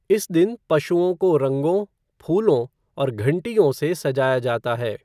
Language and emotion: Hindi, neutral